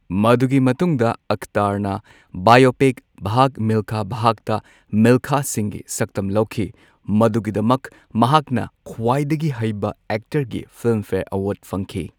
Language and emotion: Manipuri, neutral